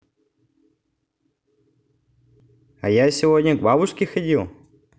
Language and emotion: Russian, positive